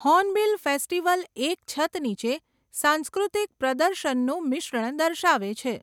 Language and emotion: Gujarati, neutral